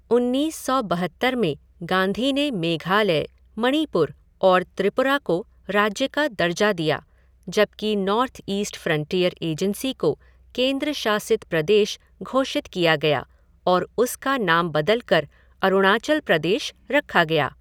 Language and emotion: Hindi, neutral